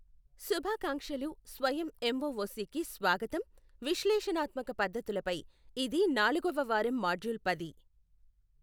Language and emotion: Telugu, neutral